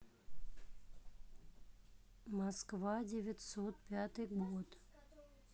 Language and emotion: Russian, neutral